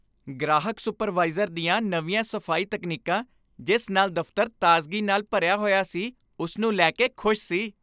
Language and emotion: Punjabi, happy